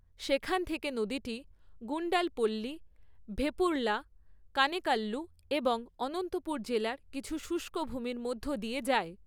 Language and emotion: Bengali, neutral